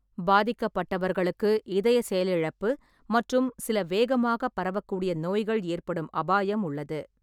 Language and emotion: Tamil, neutral